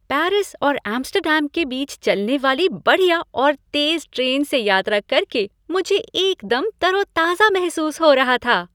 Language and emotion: Hindi, happy